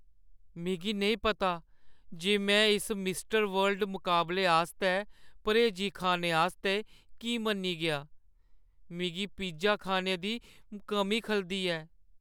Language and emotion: Dogri, sad